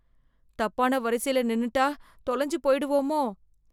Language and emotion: Tamil, fearful